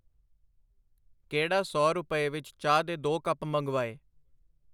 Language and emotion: Punjabi, neutral